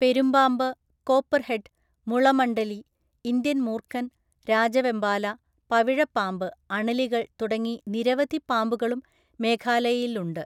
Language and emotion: Malayalam, neutral